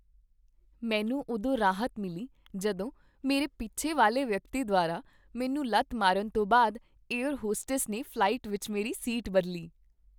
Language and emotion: Punjabi, happy